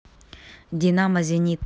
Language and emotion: Russian, neutral